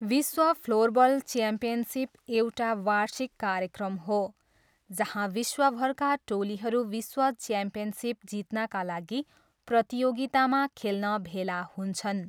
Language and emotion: Nepali, neutral